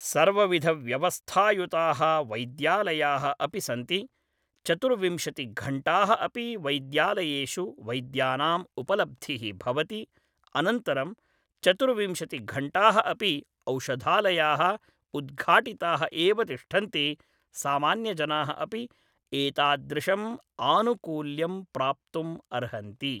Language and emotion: Sanskrit, neutral